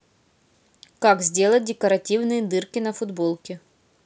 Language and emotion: Russian, neutral